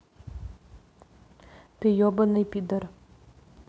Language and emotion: Russian, angry